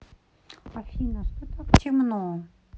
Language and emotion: Russian, neutral